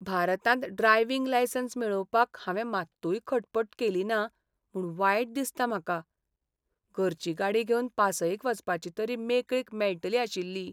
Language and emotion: Goan Konkani, sad